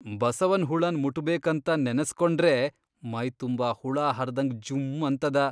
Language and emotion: Kannada, disgusted